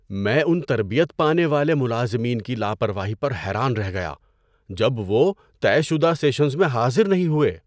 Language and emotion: Urdu, surprised